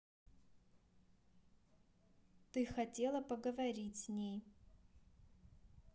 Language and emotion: Russian, neutral